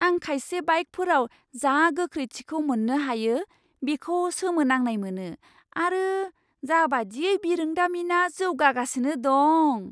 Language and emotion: Bodo, surprised